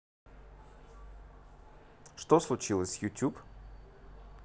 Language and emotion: Russian, neutral